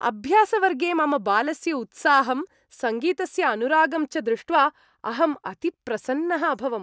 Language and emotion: Sanskrit, happy